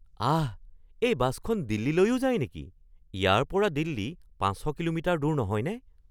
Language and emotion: Assamese, surprised